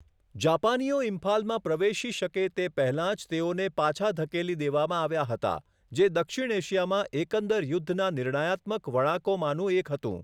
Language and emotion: Gujarati, neutral